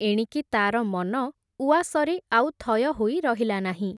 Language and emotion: Odia, neutral